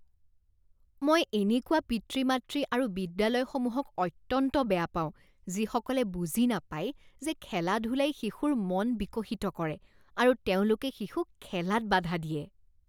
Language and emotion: Assamese, disgusted